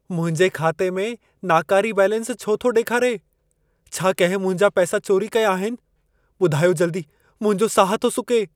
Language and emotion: Sindhi, fearful